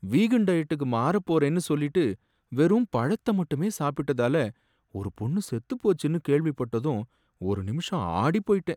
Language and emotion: Tamil, sad